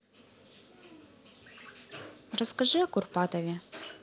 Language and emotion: Russian, neutral